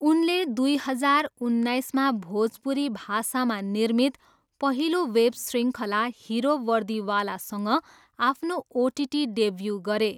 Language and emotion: Nepali, neutral